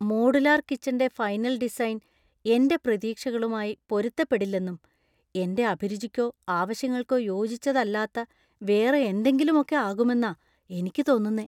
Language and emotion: Malayalam, fearful